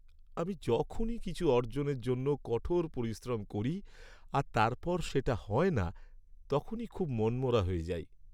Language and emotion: Bengali, sad